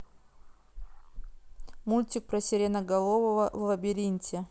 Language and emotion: Russian, neutral